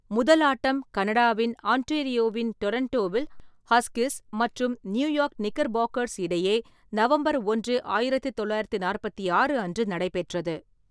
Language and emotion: Tamil, neutral